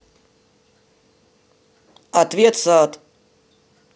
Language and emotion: Russian, neutral